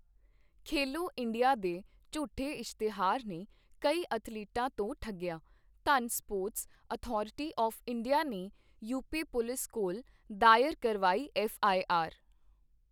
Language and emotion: Punjabi, neutral